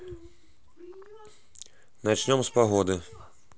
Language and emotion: Russian, neutral